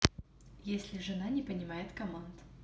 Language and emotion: Russian, neutral